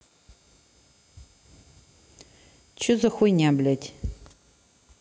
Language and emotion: Russian, neutral